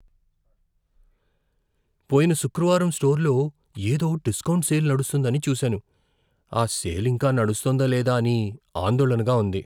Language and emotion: Telugu, fearful